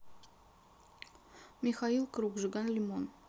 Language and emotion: Russian, neutral